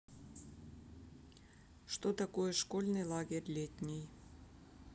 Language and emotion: Russian, neutral